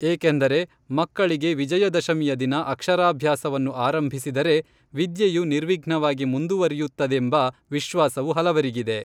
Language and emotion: Kannada, neutral